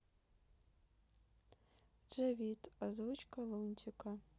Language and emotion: Russian, sad